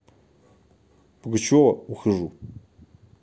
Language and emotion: Russian, neutral